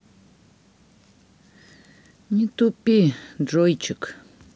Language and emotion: Russian, sad